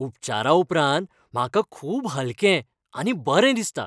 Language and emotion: Goan Konkani, happy